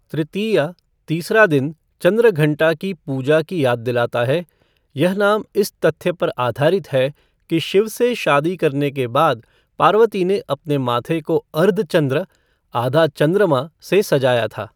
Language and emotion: Hindi, neutral